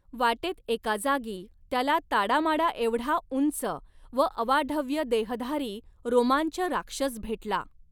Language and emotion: Marathi, neutral